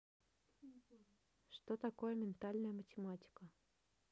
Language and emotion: Russian, neutral